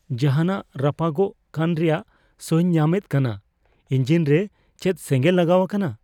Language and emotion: Santali, fearful